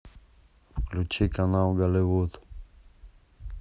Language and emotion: Russian, neutral